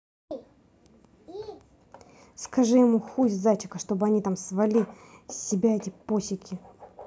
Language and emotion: Russian, angry